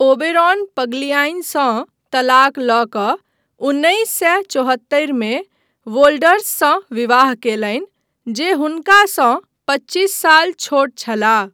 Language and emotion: Maithili, neutral